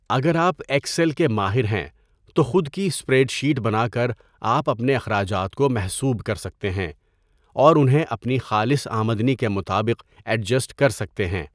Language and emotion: Urdu, neutral